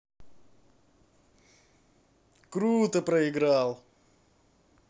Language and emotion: Russian, positive